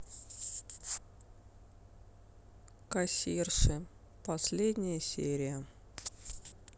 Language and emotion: Russian, sad